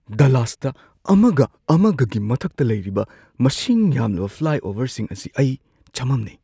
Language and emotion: Manipuri, surprised